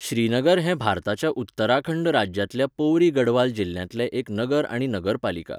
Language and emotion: Goan Konkani, neutral